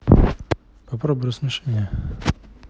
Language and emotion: Russian, neutral